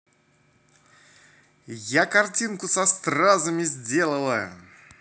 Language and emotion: Russian, positive